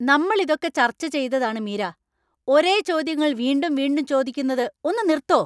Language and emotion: Malayalam, angry